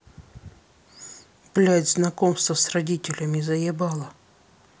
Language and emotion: Russian, angry